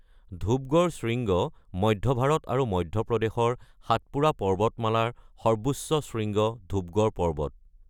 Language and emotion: Assamese, neutral